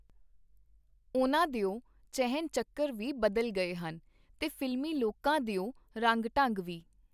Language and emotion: Punjabi, neutral